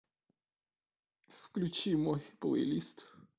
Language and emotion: Russian, sad